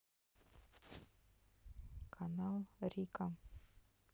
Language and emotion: Russian, neutral